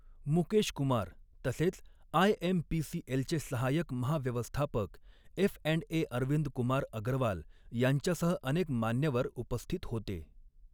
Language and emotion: Marathi, neutral